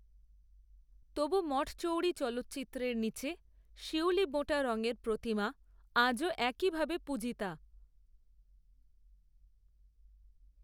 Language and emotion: Bengali, neutral